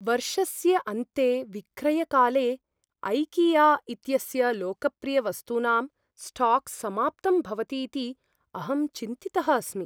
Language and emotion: Sanskrit, fearful